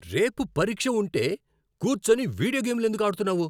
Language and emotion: Telugu, angry